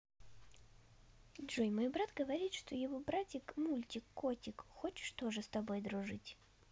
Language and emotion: Russian, neutral